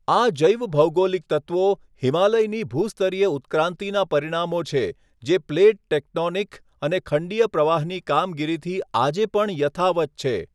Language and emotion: Gujarati, neutral